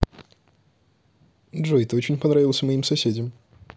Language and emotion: Russian, neutral